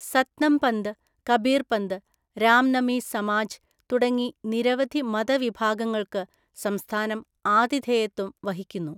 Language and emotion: Malayalam, neutral